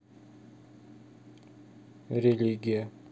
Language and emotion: Russian, neutral